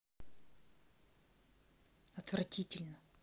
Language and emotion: Russian, angry